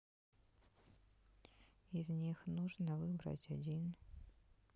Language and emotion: Russian, sad